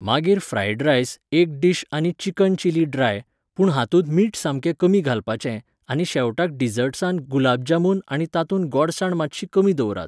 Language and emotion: Goan Konkani, neutral